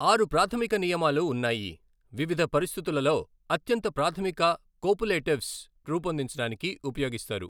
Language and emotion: Telugu, neutral